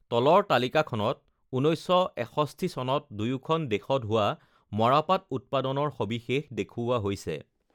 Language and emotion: Assamese, neutral